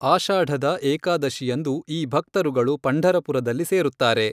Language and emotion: Kannada, neutral